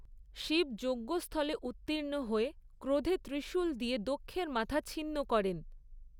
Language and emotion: Bengali, neutral